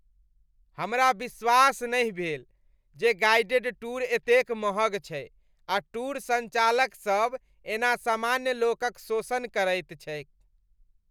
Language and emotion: Maithili, disgusted